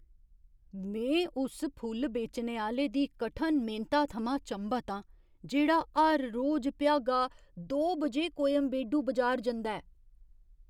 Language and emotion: Dogri, surprised